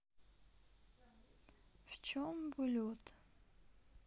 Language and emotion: Russian, sad